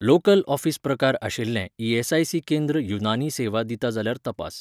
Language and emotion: Goan Konkani, neutral